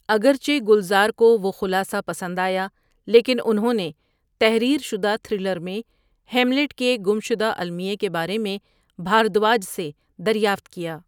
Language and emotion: Urdu, neutral